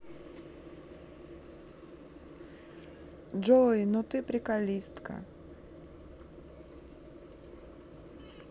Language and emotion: Russian, neutral